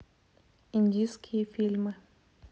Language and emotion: Russian, neutral